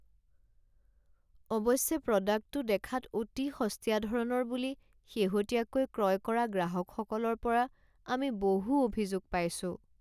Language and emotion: Assamese, sad